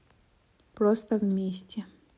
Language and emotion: Russian, neutral